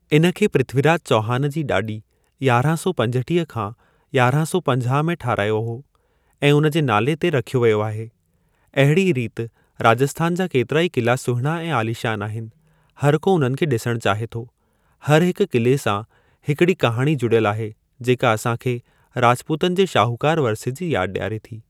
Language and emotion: Sindhi, neutral